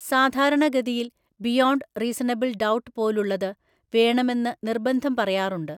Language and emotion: Malayalam, neutral